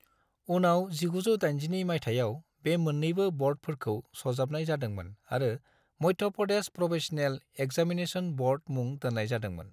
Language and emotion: Bodo, neutral